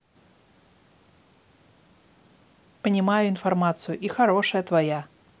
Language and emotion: Russian, neutral